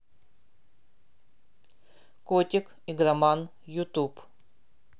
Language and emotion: Russian, neutral